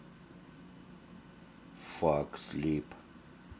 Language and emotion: Russian, neutral